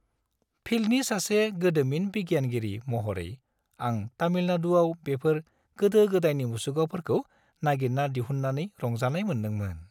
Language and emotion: Bodo, happy